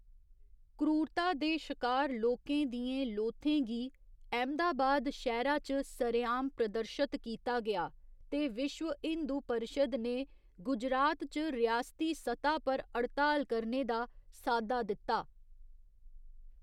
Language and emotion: Dogri, neutral